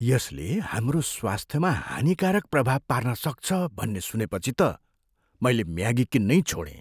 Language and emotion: Nepali, fearful